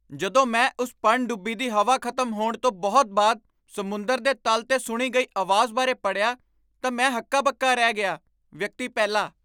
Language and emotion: Punjabi, surprised